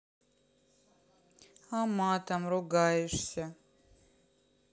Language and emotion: Russian, sad